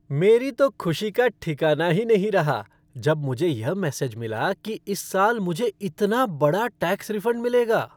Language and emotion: Hindi, happy